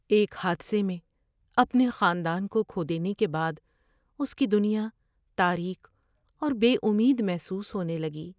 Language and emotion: Urdu, sad